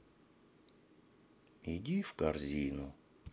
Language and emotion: Russian, sad